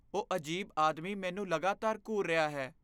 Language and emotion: Punjabi, fearful